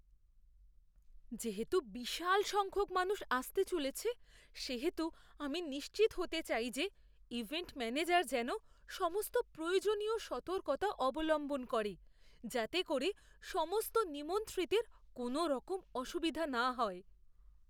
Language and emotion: Bengali, fearful